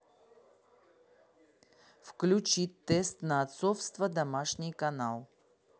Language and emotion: Russian, neutral